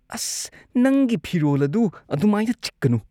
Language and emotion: Manipuri, disgusted